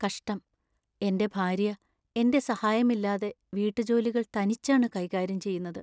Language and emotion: Malayalam, sad